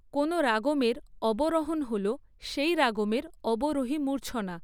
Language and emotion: Bengali, neutral